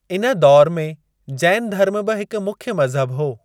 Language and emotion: Sindhi, neutral